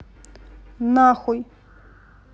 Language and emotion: Russian, neutral